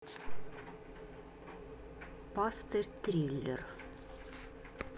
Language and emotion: Russian, neutral